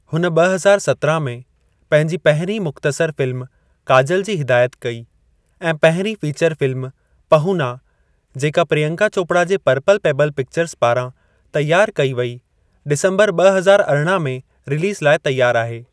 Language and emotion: Sindhi, neutral